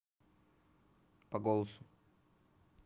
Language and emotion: Russian, neutral